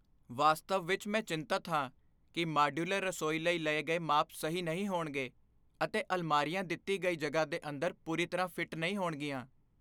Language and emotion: Punjabi, fearful